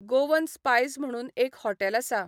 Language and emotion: Goan Konkani, neutral